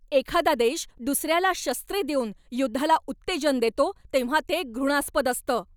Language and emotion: Marathi, angry